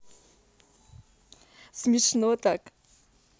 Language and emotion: Russian, positive